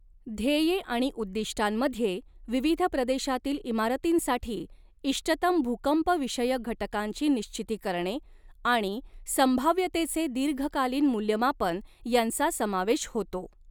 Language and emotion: Marathi, neutral